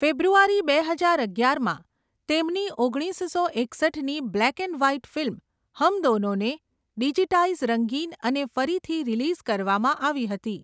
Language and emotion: Gujarati, neutral